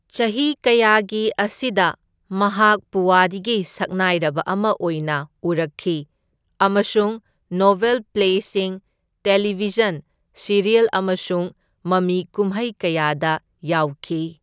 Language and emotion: Manipuri, neutral